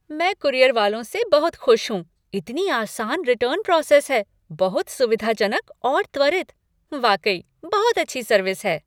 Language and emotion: Hindi, happy